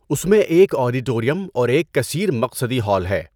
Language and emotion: Urdu, neutral